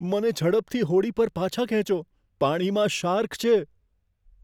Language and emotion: Gujarati, fearful